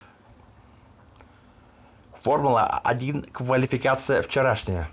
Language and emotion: Russian, neutral